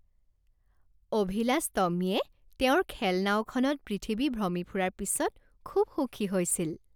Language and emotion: Assamese, happy